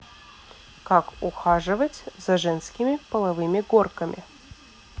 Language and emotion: Russian, neutral